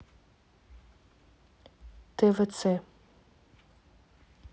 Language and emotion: Russian, neutral